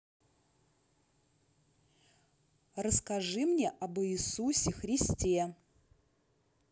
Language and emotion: Russian, neutral